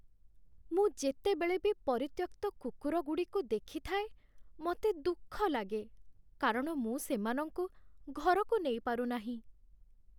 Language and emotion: Odia, sad